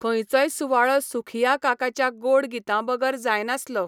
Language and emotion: Goan Konkani, neutral